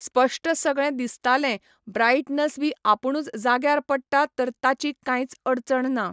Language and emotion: Goan Konkani, neutral